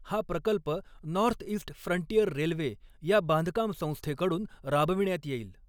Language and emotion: Marathi, neutral